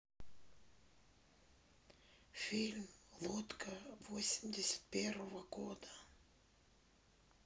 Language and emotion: Russian, neutral